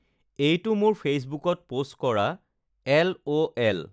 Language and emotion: Assamese, neutral